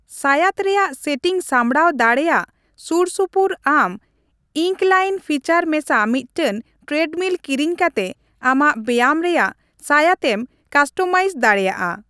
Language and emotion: Santali, neutral